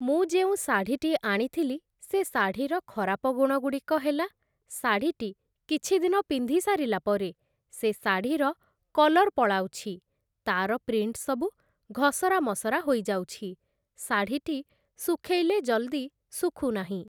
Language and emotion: Odia, neutral